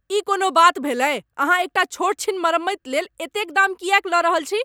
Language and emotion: Maithili, angry